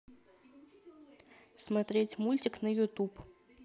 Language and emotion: Russian, neutral